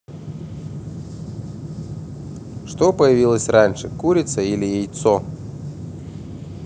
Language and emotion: Russian, neutral